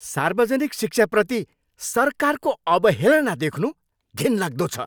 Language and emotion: Nepali, angry